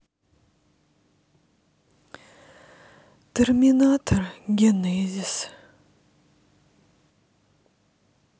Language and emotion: Russian, sad